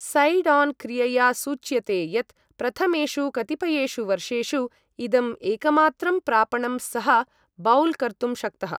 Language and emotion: Sanskrit, neutral